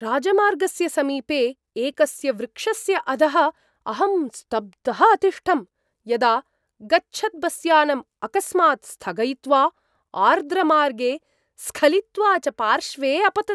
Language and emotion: Sanskrit, surprised